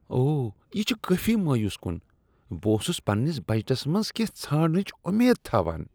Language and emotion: Kashmiri, disgusted